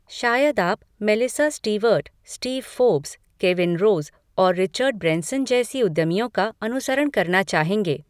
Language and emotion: Hindi, neutral